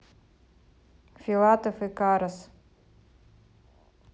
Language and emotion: Russian, neutral